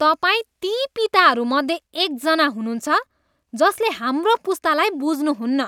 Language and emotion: Nepali, disgusted